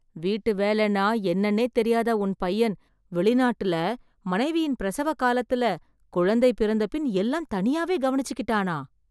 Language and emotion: Tamil, surprised